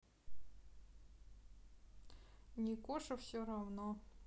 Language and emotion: Russian, neutral